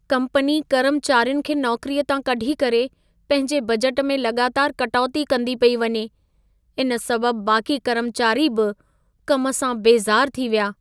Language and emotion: Sindhi, sad